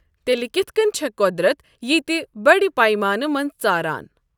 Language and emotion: Kashmiri, neutral